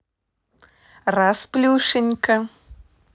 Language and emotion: Russian, positive